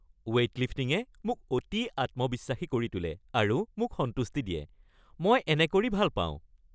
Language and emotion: Assamese, happy